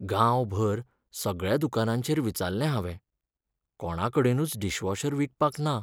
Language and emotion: Goan Konkani, sad